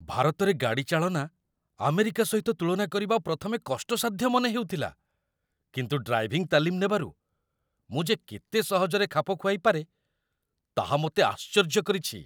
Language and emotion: Odia, surprised